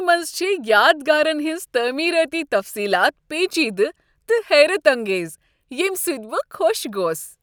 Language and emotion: Kashmiri, happy